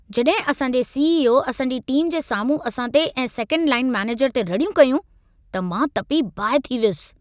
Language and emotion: Sindhi, angry